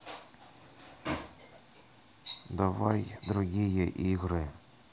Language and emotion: Russian, neutral